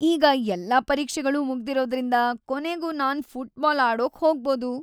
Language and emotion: Kannada, happy